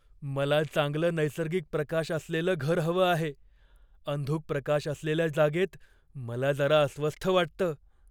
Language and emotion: Marathi, fearful